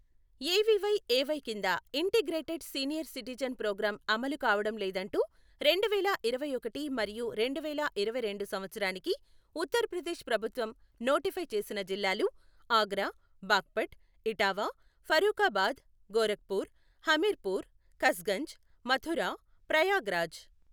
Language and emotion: Telugu, neutral